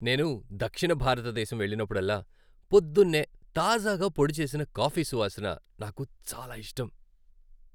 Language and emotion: Telugu, happy